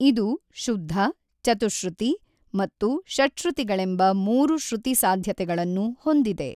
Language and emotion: Kannada, neutral